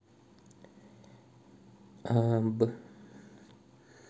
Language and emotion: Russian, neutral